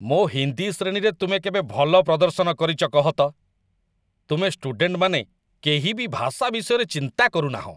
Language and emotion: Odia, disgusted